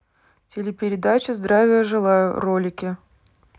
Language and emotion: Russian, neutral